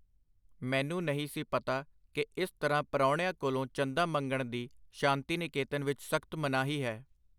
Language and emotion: Punjabi, neutral